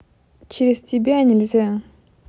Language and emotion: Russian, neutral